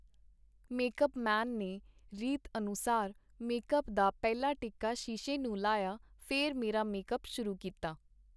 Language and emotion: Punjabi, neutral